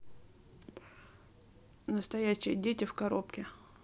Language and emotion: Russian, neutral